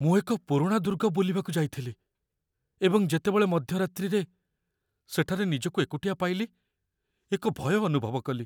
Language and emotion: Odia, fearful